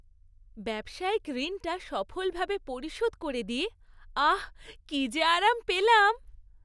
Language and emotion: Bengali, happy